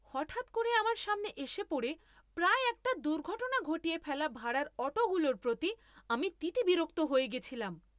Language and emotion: Bengali, angry